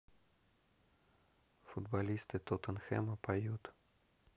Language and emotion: Russian, neutral